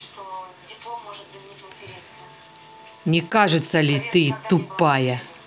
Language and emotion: Russian, angry